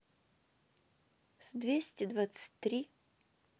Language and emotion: Russian, neutral